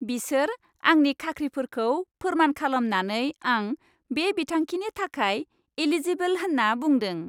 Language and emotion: Bodo, happy